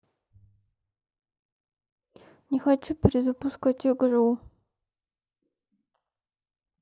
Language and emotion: Russian, sad